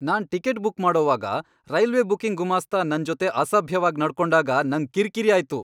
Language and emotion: Kannada, angry